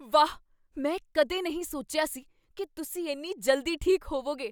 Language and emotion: Punjabi, surprised